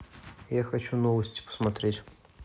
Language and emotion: Russian, neutral